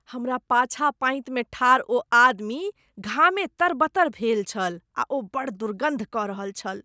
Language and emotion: Maithili, disgusted